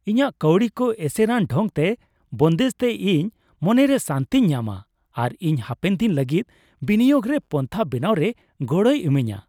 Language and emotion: Santali, happy